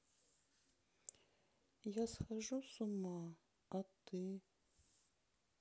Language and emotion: Russian, sad